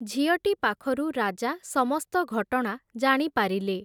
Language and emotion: Odia, neutral